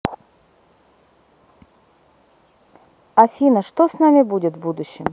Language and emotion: Russian, neutral